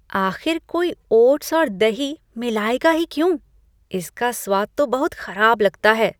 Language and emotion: Hindi, disgusted